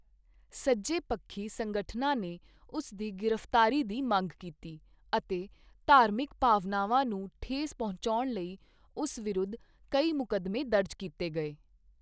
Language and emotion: Punjabi, neutral